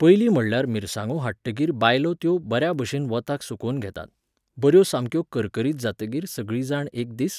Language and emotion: Goan Konkani, neutral